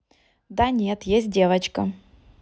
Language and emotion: Russian, neutral